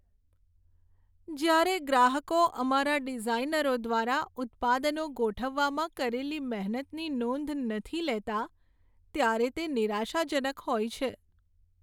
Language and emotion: Gujarati, sad